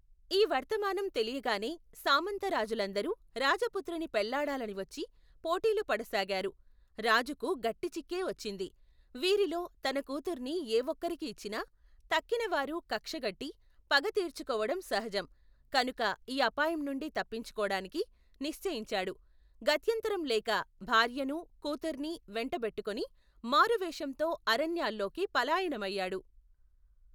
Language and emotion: Telugu, neutral